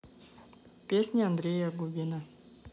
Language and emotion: Russian, neutral